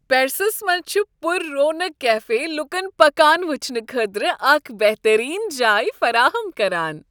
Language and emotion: Kashmiri, happy